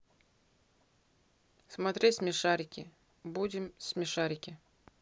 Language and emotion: Russian, neutral